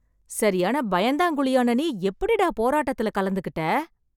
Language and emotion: Tamil, surprised